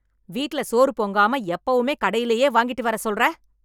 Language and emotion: Tamil, angry